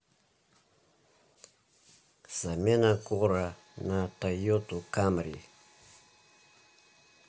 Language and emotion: Russian, neutral